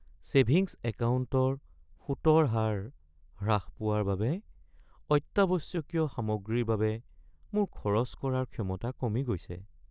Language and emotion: Assamese, sad